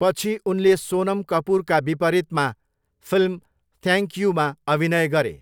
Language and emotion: Nepali, neutral